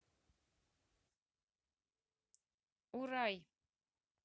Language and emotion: Russian, neutral